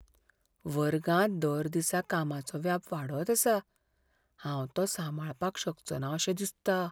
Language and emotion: Goan Konkani, fearful